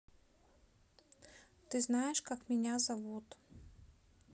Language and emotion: Russian, neutral